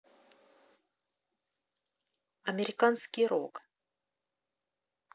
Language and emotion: Russian, neutral